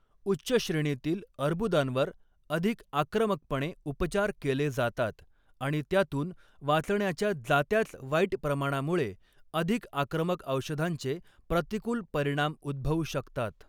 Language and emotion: Marathi, neutral